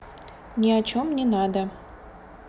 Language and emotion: Russian, neutral